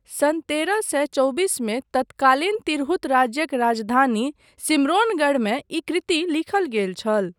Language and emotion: Maithili, neutral